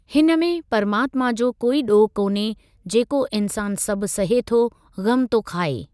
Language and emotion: Sindhi, neutral